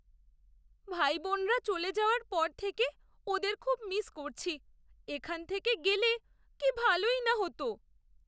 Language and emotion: Bengali, sad